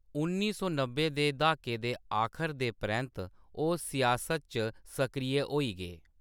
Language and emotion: Dogri, neutral